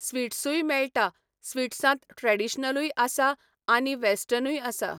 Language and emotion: Goan Konkani, neutral